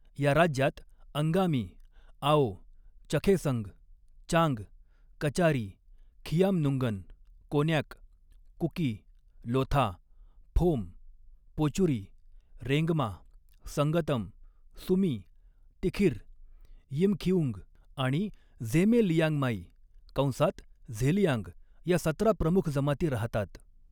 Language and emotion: Marathi, neutral